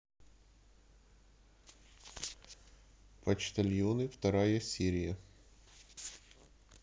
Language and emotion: Russian, neutral